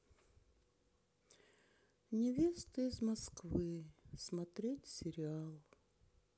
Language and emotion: Russian, sad